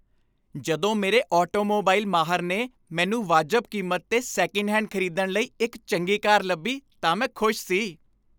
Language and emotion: Punjabi, happy